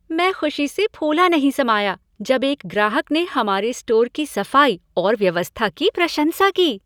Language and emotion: Hindi, happy